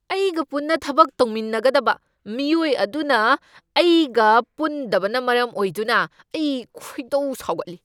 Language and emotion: Manipuri, angry